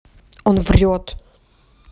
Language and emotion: Russian, angry